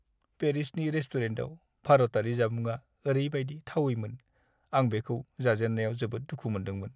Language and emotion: Bodo, sad